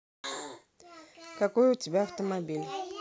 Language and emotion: Russian, neutral